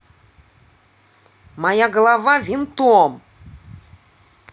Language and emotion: Russian, angry